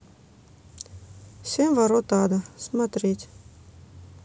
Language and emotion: Russian, neutral